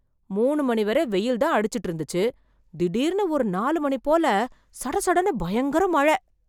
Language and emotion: Tamil, surprised